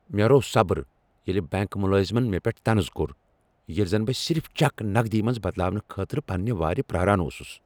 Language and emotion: Kashmiri, angry